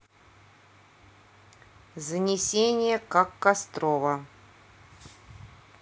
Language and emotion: Russian, neutral